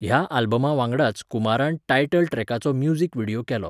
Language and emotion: Goan Konkani, neutral